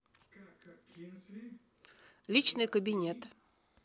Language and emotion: Russian, neutral